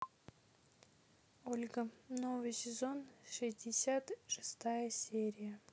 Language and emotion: Russian, neutral